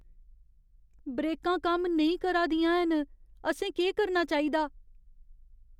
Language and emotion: Dogri, fearful